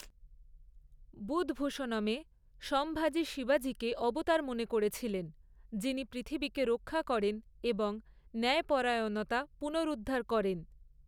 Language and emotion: Bengali, neutral